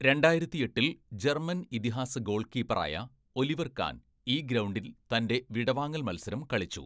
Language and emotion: Malayalam, neutral